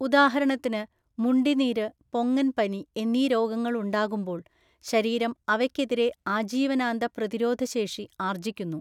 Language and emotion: Malayalam, neutral